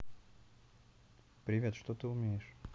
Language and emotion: Russian, neutral